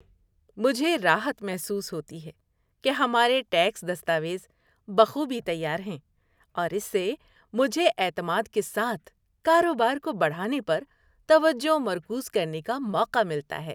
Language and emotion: Urdu, happy